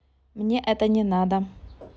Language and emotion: Russian, neutral